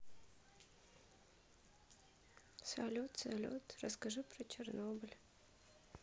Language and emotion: Russian, sad